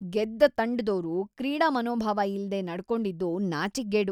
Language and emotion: Kannada, disgusted